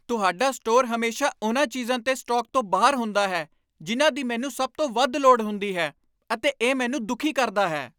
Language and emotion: Punjabi, angry